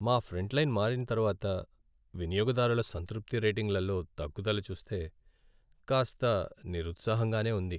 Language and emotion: Telugu, sad